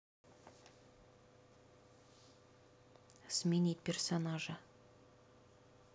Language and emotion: Russian, neutral